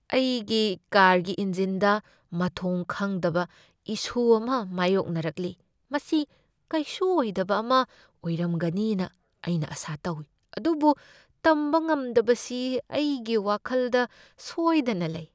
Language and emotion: Manipuri, fearful